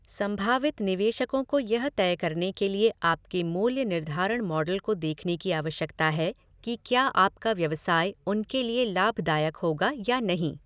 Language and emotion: Hindi, neutral